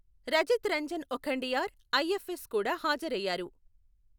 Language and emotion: Telugu, neutral